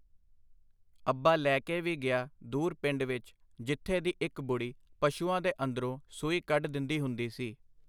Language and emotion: Punjabi, neutral